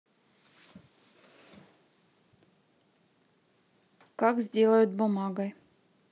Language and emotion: Russian, neutral